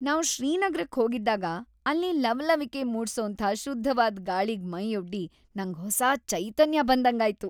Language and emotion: Kannada, happy